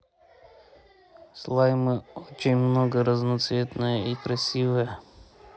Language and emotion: Russian, neutral